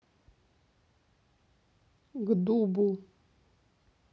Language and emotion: Russian, neutral